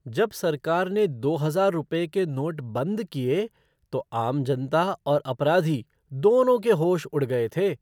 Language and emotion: Hindi, surprised